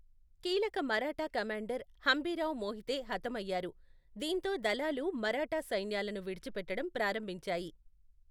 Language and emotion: Telugu, neutral